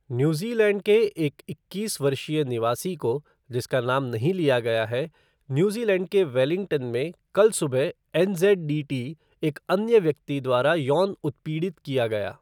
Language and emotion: Hindi, neutral